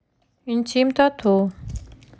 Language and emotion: Russian, neutral